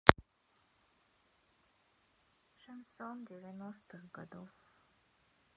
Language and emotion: Russian, sad